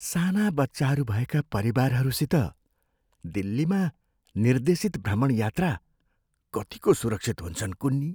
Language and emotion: Nepali, fearful